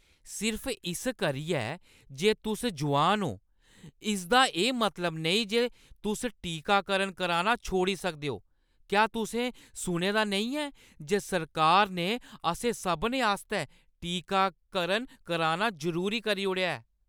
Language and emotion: Dogri, angry